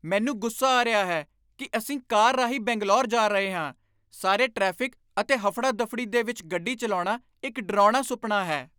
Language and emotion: Punjabi, angry